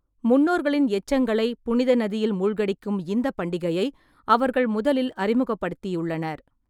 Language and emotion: Tamil, neutral